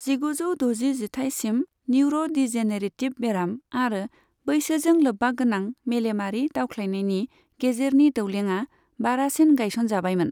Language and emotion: Bodo, neutral